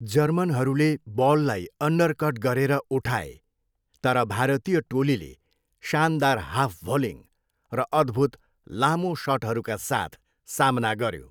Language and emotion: Nepali, neutral